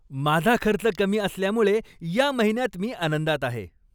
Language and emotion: Marathi, happy